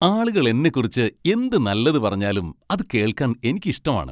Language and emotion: Malayalam, happy